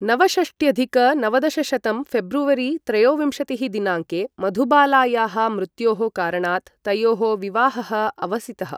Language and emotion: Sanskrit, neutral